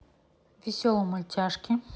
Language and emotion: Russian, neutral